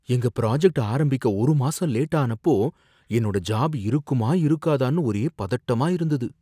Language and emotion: Tamil, fearful